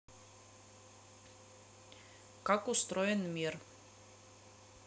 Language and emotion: Russian, neutral